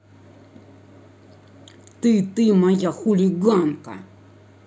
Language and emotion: Russian, angry